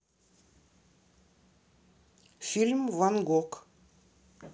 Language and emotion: Russian, neutral